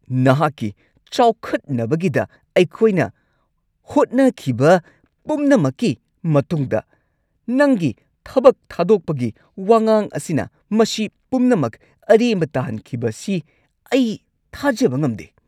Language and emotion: Manipuri, angry